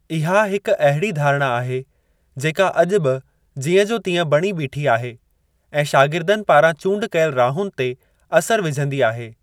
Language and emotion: Sindhi, neutral